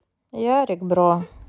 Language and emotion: Russian, sad